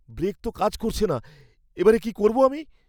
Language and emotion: Bengali, fearful